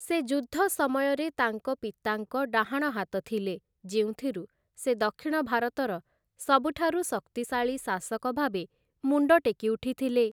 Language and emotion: Odia, neutral